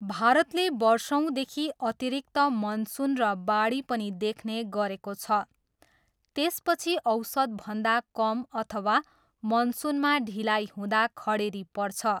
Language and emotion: Nepali, neutral